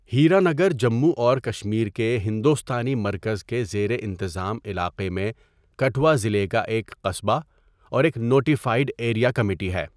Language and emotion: Urdu, neutral